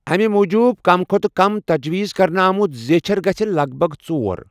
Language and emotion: Kashmiri, neutral